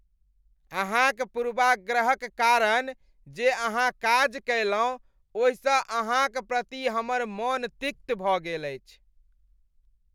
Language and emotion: Maithili, disgusted